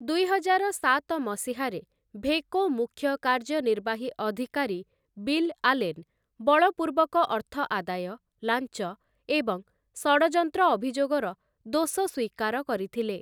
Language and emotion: Odia, neutral